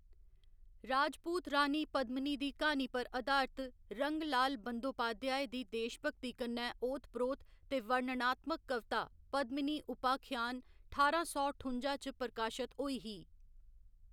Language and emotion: Dogri, neutral